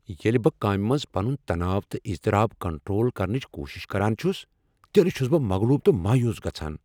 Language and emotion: Kashmiri, angry